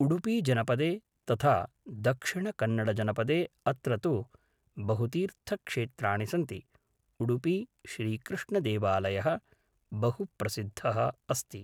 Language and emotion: Sanskrit, neutral